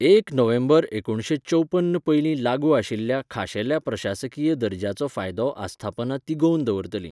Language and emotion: Goan Konkani, neutral